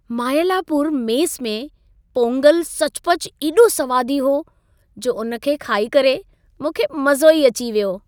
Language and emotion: Sindhi, happy